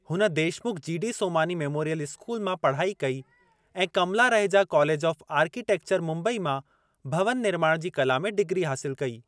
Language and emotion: Sindhi, neutral